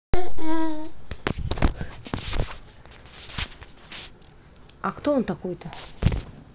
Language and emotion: Russian, neutral